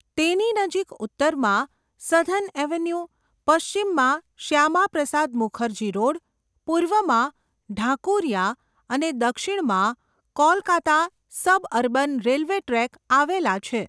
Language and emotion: Gujarati, neutral